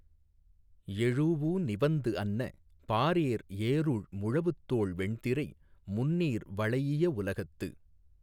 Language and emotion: Tamil, neutral